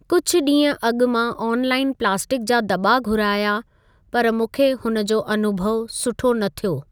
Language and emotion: Sindhi, neutral